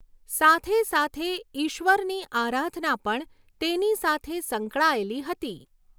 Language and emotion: Gujarati, neutral